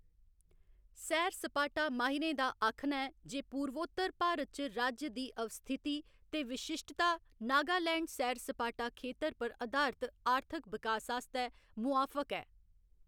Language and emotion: Dogri, neutral